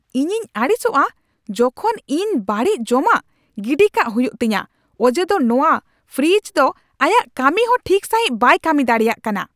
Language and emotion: Santali, angry